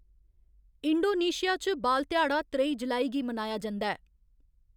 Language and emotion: Dogri, neutral